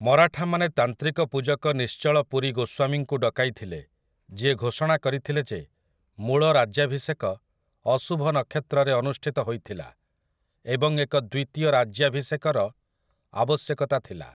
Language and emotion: Odia, neutral